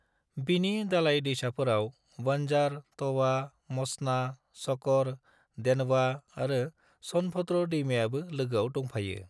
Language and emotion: Bodo, neutral